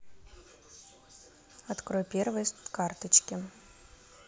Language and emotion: Russian, neutral